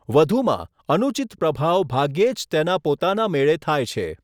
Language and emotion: Gujarati, neutral